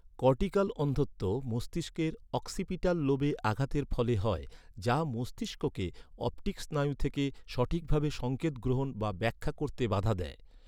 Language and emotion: Bengali, neutral